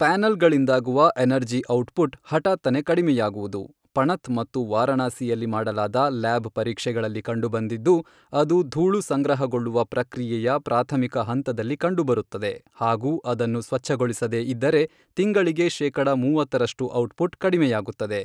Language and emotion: Kannada, neutral